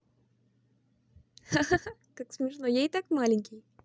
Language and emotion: Russian, positive